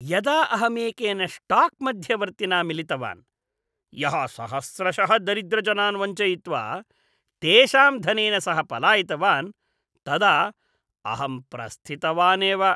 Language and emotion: Sanskrit, disgusted